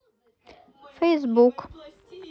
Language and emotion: Russian, neutral